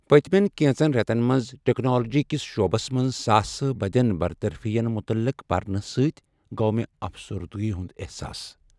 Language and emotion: Kashmiri, sad